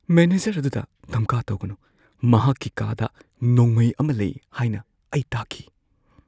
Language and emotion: Manipuri, fearful